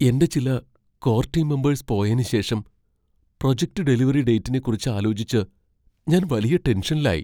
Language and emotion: Malayalam, fearful